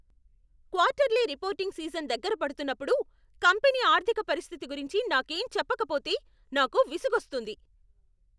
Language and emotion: Telugu, angry